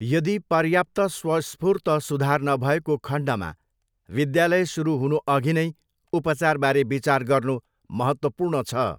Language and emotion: Nepali, neutral